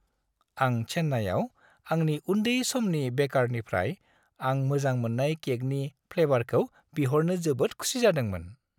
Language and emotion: Bodo, happy